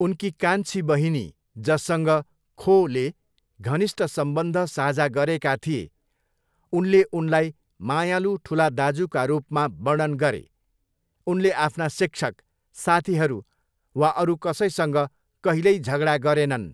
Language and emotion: Nepali, neutral